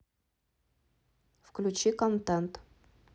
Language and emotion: Russian, neutral